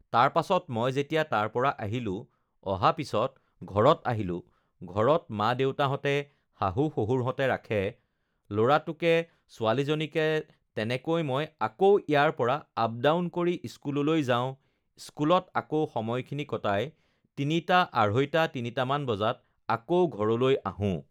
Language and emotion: Assamese, neutral